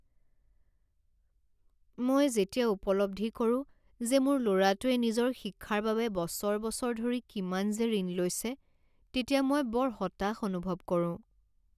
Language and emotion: Assamese, sad